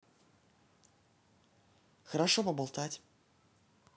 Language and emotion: Russian, neutral